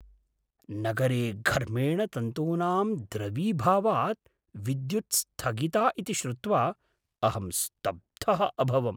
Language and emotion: Sanskrit, surprised